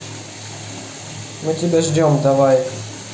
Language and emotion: Russian, neutral